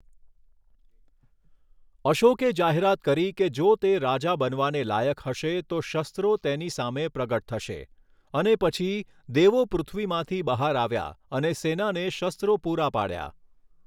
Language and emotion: Gujarati, neutral